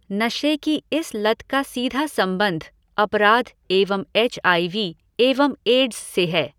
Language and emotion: Hindi, neutral